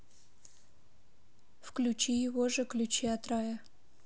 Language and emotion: Russian, neutral